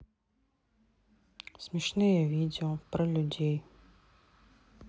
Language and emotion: Russian, sad